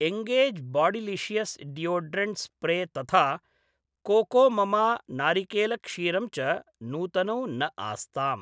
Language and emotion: Sanskrit, neutral